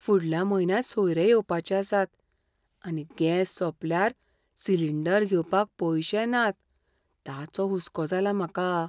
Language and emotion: Goan Konkani, fearful